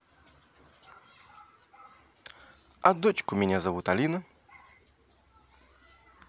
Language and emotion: Russian, positive